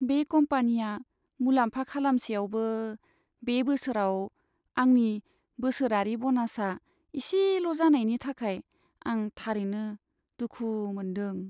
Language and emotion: Bodo, sad